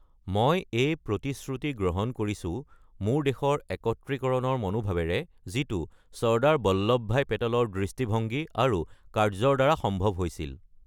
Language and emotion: Assamese, neutral